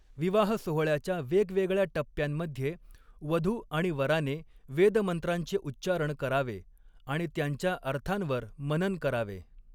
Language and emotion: Marathi, neutral